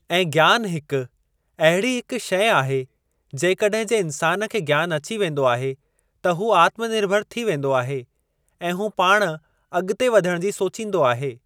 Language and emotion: Sindhi, neutral